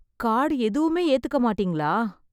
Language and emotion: Tamil, sad